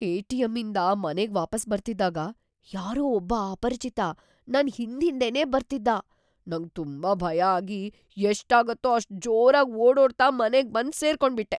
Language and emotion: Kannada, fearful